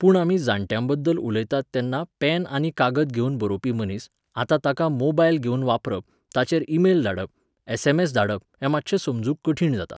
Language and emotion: Goan Konkani, neutral